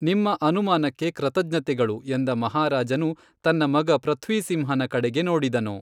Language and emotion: Kannada, neutral